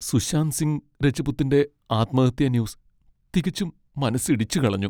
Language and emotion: Malayalam, sad